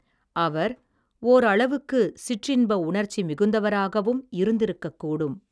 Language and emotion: Tamil, neutral